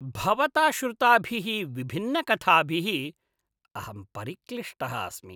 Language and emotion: Sanskrit, disgusted